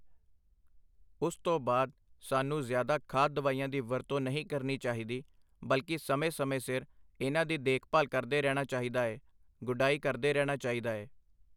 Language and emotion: Punjabi, neutral